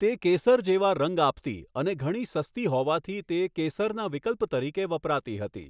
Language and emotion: Gujarati, neutral